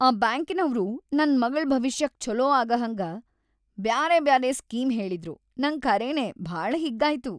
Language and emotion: Kannada, happy